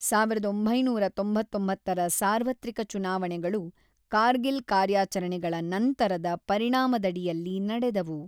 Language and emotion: Kannada, neutral